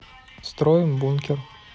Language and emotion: Russian, neutral